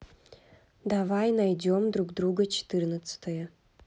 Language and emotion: Russian, neutral